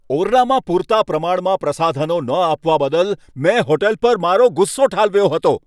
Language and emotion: Gujarati, angry